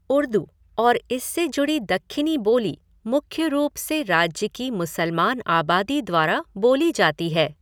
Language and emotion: Hindi, neutral